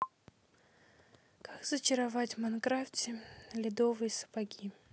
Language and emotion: Russian, sad